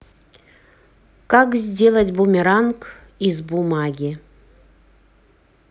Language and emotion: Russian, neutral